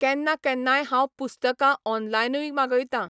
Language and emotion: Goan Konkani, neutral